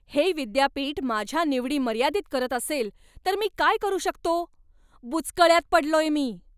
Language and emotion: Marathi, angry